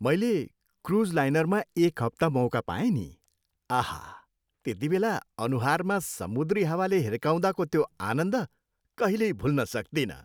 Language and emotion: Nepali, happy